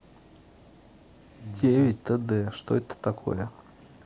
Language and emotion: Russian, neutral